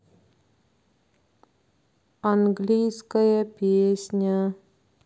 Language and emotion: Russian, neutral